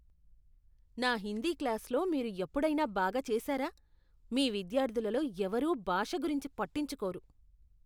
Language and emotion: Telugu, disgusted